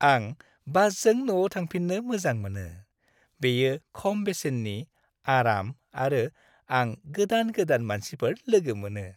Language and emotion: Bodo, happy